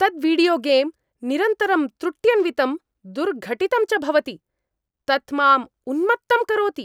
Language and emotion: Sanskrit, angry